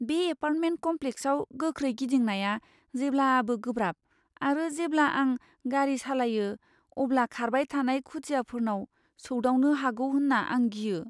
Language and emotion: Bodo, fearful